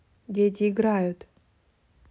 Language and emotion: Russian, neutral